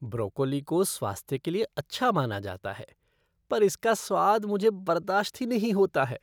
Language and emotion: Hindi, disgusted